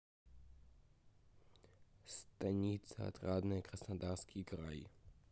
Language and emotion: Russian, neutral